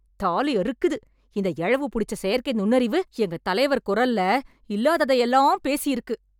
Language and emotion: Tamil, angry